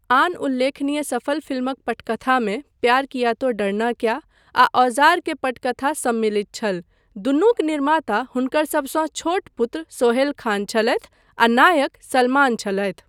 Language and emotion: Maithili, neutral